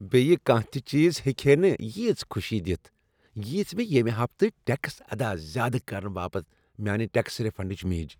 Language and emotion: Kashmiri, happy